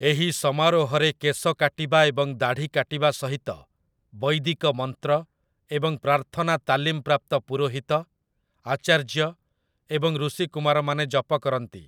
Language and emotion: Odia, neutral